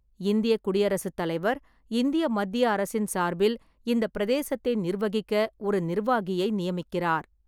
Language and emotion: Tamil, neutral